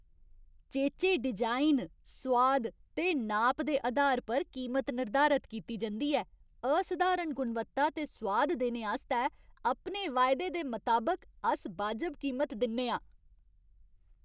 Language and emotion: Dogri, happy